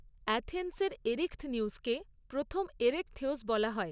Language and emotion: Bengali, neutral